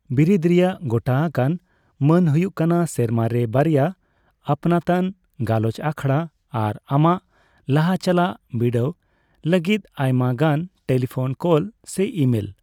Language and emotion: Santali, neutral